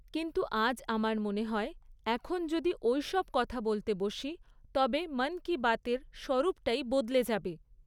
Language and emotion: Bengali, neutral